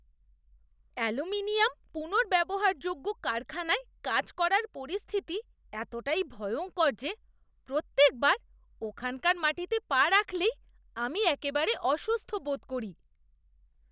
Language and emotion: Bengali, disgusted